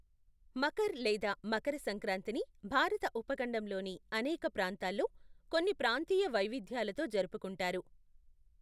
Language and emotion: Telugu, neutral